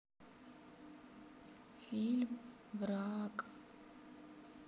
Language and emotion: Russian, sad